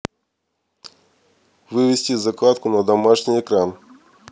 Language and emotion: Russian, neutral